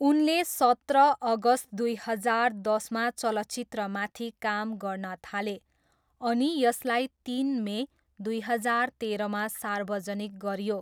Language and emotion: Nepali, neutral